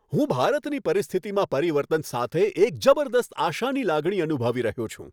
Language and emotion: Gujarati, happy